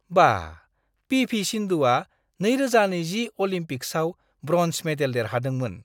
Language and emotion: Bodo, surprised